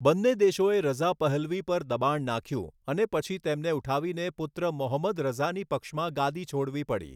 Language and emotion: Gujarati, neutral